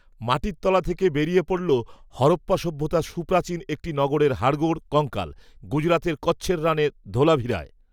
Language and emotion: Bengali, neutral